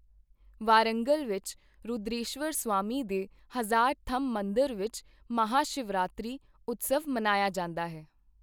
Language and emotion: Punjabi, neutral